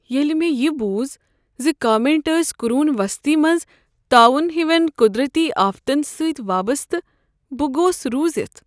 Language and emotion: Kashmiri, sad